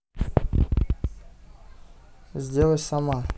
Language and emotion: Russian, neutral